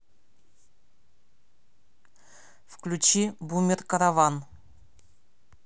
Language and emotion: Russian, neutral